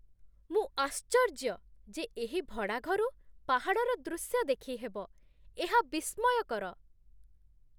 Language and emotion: Odia, surprised